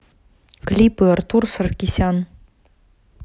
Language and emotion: Russian, neutral